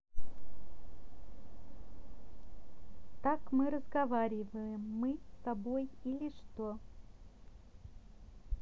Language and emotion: Russian, neutral